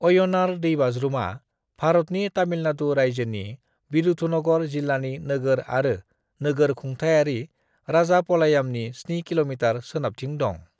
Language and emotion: Bodo, neutral